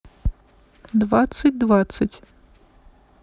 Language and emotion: Russian, neutral